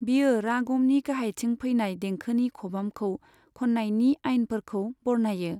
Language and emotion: Bodo, neutral